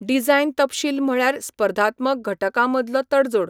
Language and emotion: Goan Konkani, neutral